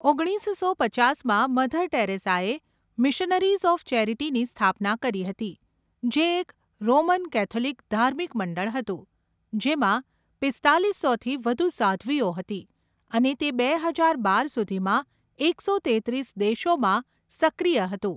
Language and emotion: Gujarati, neutral